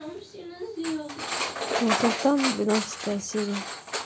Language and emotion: Russian, neutral